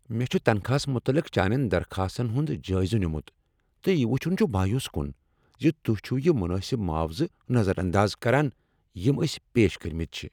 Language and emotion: Kashmiri, angry